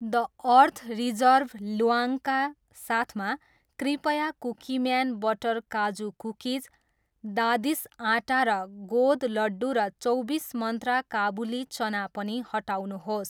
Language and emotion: Nepali, neutral